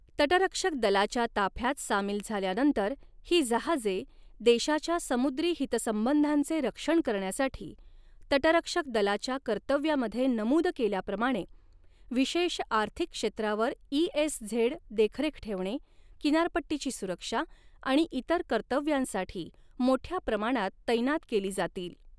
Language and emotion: Marathi, neutral